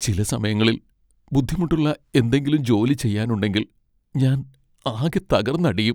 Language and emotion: Malayalam, sad